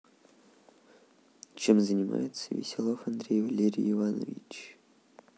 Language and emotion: Russian, neutral